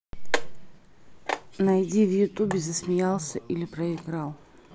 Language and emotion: Russian, neutral